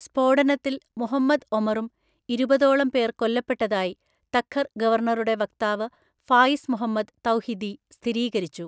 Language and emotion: Malayalam, neutral